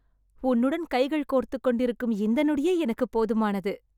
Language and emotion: Tamil, happy